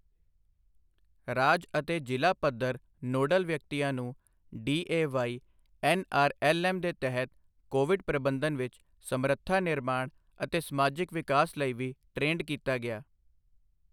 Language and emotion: Punjabi, neutral